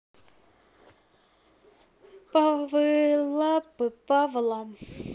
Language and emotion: Russian, neutral